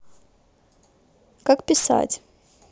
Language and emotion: Russian, neutral